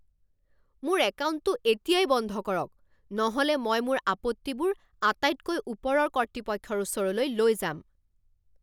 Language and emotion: Assamese, angry